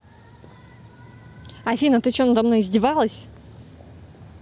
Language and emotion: Russian, angry